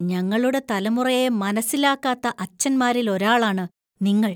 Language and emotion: Malayalam, disgusted